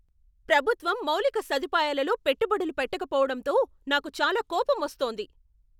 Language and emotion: Telugu, angry